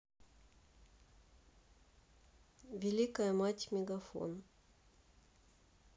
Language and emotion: Russian, neutral